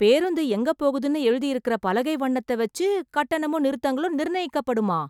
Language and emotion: Tamil, surprised